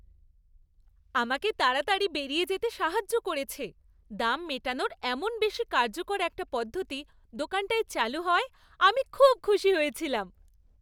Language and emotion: Bengali, happy